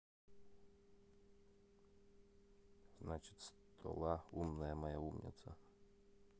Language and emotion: Russian, neutral